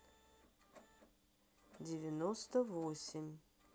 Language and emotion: Russian, neutral